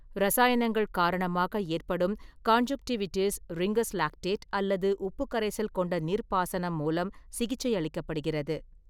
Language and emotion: Tamil, neutral